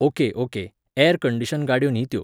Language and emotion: Goan Konkani, neutral